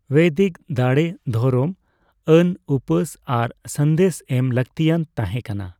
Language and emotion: Santali, neutral